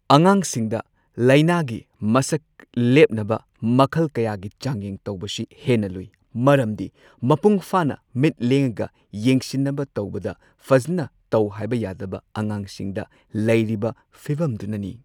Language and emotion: Manipuri, neutral